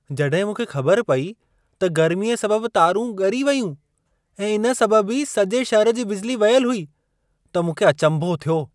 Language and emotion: Sindhi, surprised